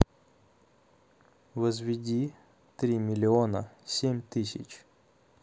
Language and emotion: Russian, neutral